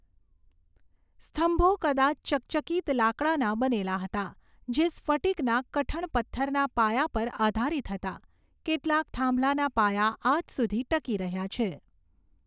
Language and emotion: Gujarati, neutral